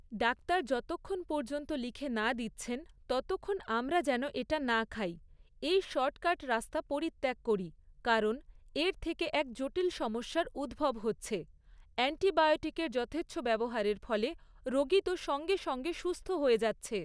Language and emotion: Bengali, neutral